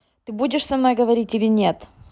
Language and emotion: Russian, angry